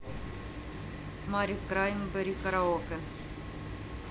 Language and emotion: Russian, neutral